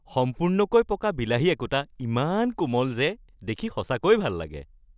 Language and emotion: Assamese, happy